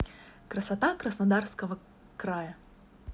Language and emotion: Russian, positive